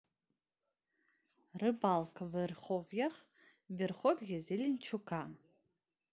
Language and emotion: Russian, neutral